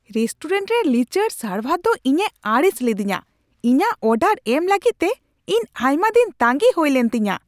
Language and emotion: Santali, angry